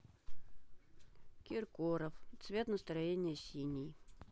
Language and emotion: Russian, sad